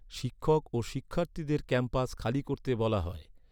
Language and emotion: Bengali, neutral